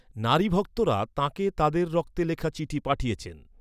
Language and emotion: Bengali, neutral